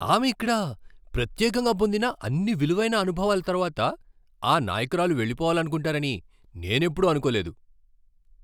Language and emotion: Telugu, surprised